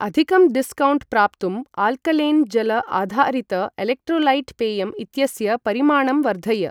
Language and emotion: Sanskrit, neutral